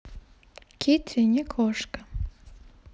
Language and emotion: Russian, neutral